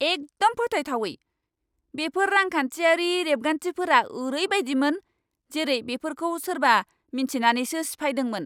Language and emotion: Bodo, angry